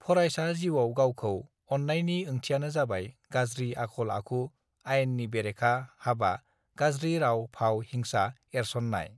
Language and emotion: Bodo, neutral